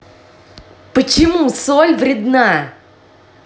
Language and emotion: Russian, angry